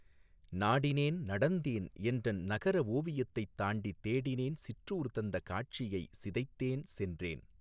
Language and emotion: Tamil, neutral